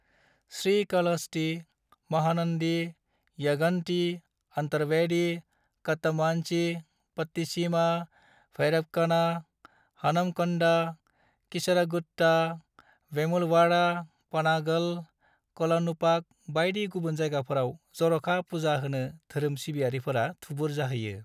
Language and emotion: Bodo, neutral